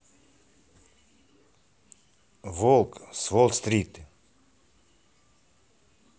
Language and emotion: Russian, neutral